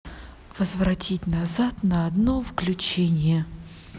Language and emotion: Russian, positive